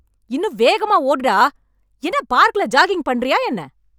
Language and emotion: Tamil, angry